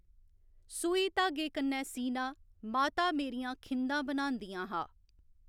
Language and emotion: Dogri, neutral